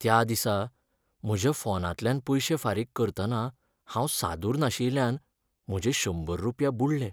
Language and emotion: Goan Konkani, sad